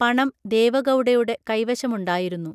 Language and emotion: Malayalam, neutral